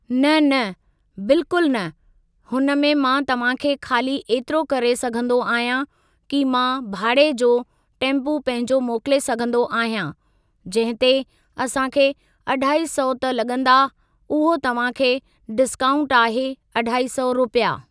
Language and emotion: Sindhi, neutral